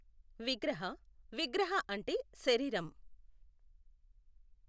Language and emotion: Telugu, neutral